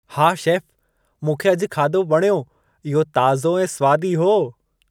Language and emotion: Sindhi, happy